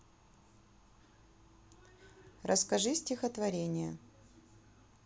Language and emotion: Russian, neutral